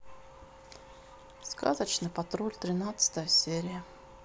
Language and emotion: Russian, neutral